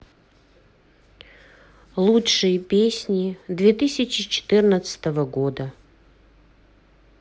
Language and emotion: Russian, neutral